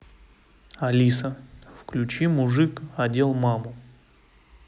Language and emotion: Russian, neutral